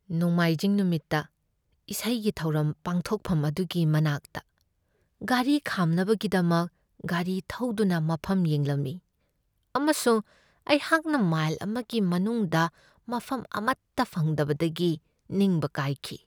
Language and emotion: Manipuri, sad